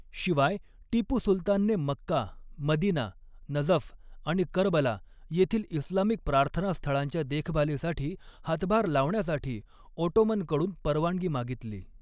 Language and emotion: Marathi, neutral